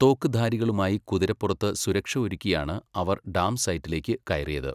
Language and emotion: Malayalam, neutral